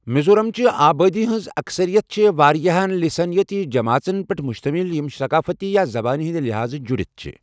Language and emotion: Kashmiri, neutral